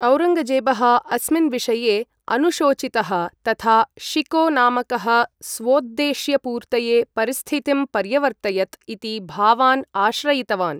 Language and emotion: Sanskrit, neutral